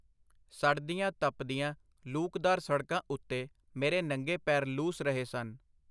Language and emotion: Punjabi, neutral